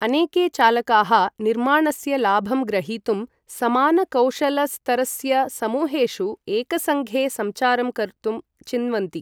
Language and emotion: Sanskrit, neutral